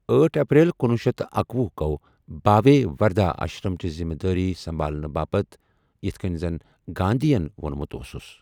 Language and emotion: Kashmiri, neutral